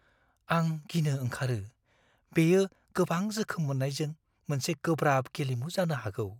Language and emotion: Bodo, fearful